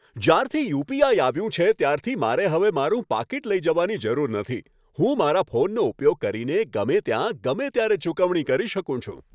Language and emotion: Gujarati, happy